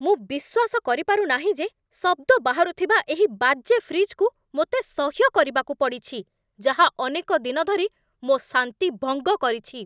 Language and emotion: Odia, angry